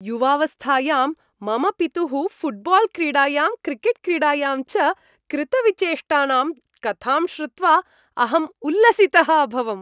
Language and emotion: Sanskrit, happy